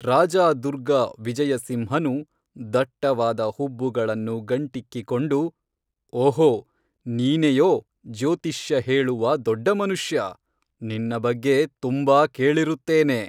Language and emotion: Kannada, neutral